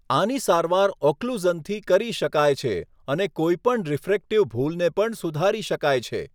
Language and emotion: Gujarati, neutral